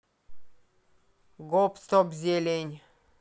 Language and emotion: Russian, neutral